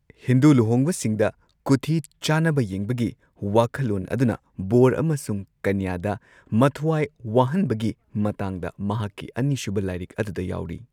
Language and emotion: Manipuri, neutral